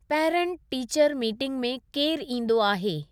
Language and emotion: Sindhi, neutral